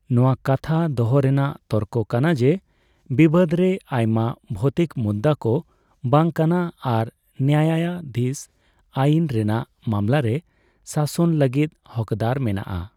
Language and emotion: Santali, neutral